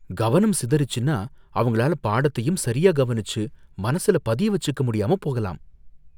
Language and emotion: Tamil, fearful